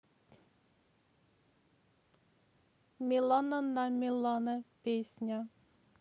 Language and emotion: Russian, neutral